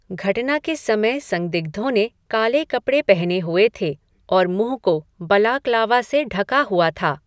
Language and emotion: Hindi, neutral